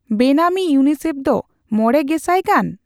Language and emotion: Santali, neutral